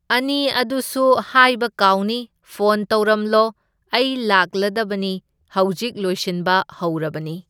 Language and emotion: Manipuri, neutral